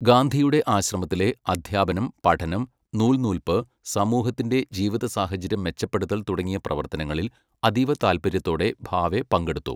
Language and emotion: Malayalam, neutral